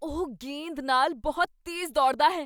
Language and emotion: Punjabi, surprised